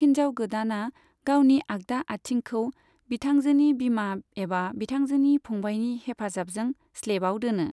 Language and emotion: Bodo, neutral